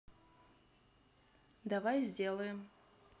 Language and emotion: Russian, neutral